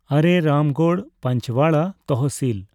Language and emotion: Santali, neutral